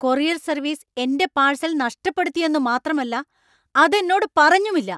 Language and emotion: Malayalam, angry